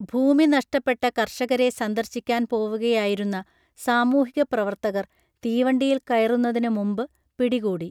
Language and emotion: Malayalam, neutral